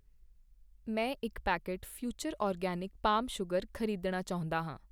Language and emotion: Punjabi, neutral